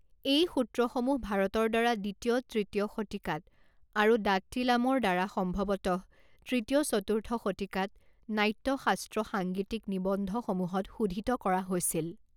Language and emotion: Assamese, neutral